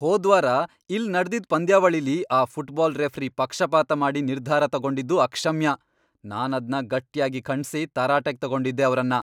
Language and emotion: Kannada, angry